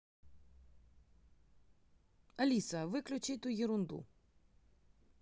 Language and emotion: Russian, neutral